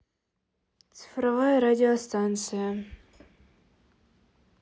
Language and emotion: Russian, neutral